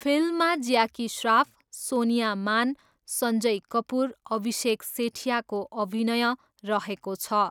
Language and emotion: Nepali, neutral